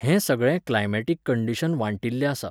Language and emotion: Goan Konkani, neutral